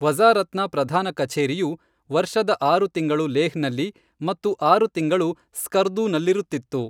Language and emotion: Kannada, neutral